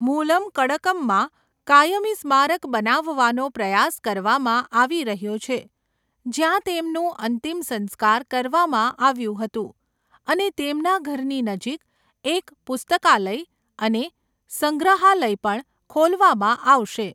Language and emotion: Gujarati, neutral